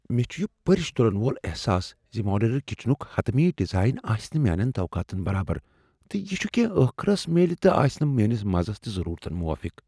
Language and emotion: Kashmiri, fearful